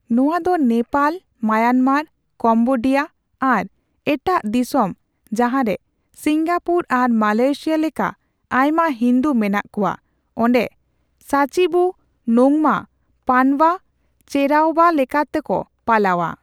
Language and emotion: Santali, neutral